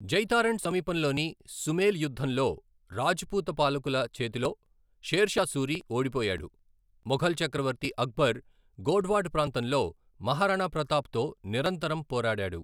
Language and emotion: Telugu, neutral